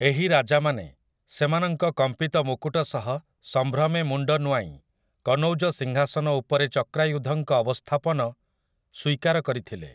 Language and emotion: Odia, neutral